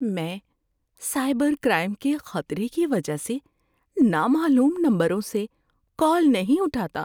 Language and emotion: Urdu, fearful